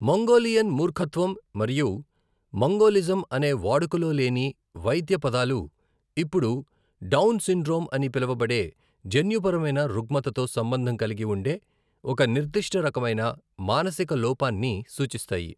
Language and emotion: Telugu, neutral